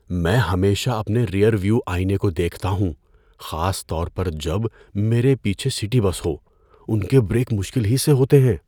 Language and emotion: Urdu, fearful